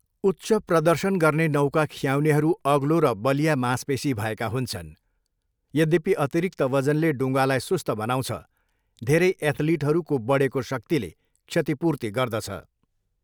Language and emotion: Nepali, neutral